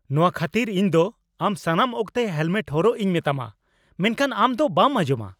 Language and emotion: Santali, angry